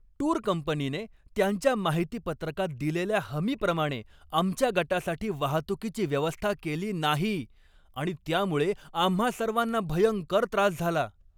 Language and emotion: Marathi, angry